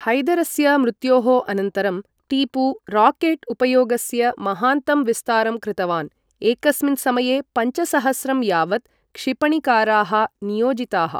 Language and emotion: Sanskrit, neutral